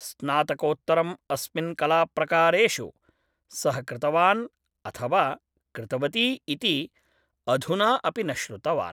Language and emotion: Sanskrit, neutral